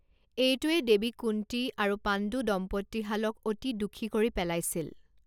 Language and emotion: Assamese, neutral